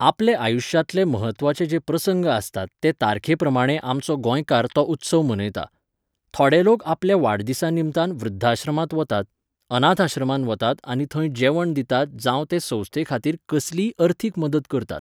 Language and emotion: Goan Konkani, neutral